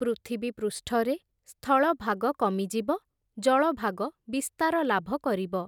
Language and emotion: Odia, neutral